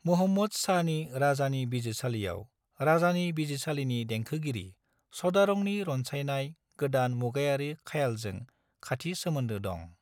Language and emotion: Bodo, neutral